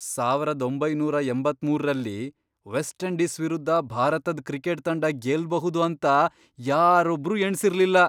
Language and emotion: Kannada, surprised